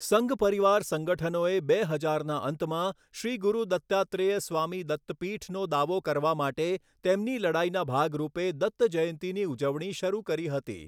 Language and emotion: Gujarati, neutral